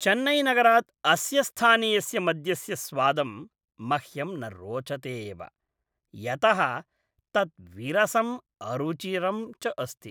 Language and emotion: Sanskrit, disgusted